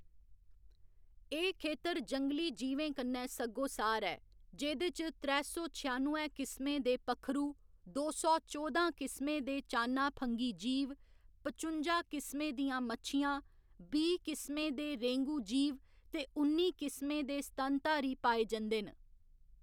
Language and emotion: Dogri, neutral